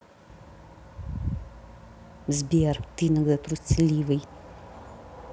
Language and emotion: Russian, angry